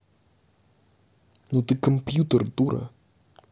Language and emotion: Russian, angry